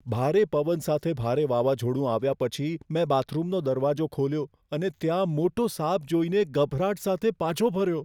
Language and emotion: Gujarati, fearful